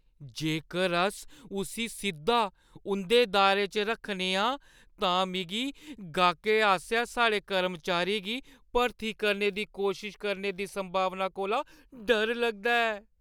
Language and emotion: Dogri, fearful